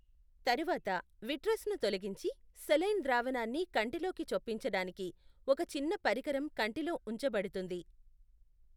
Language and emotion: Telugu, neutral